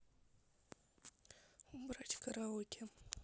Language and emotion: Russian, neutral